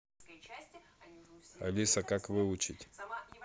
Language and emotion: Russian, neutral